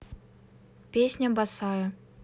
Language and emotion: Russian, neutral